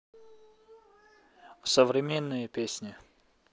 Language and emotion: Russian, neutral